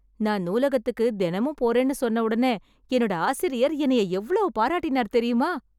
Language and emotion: Tamil, happy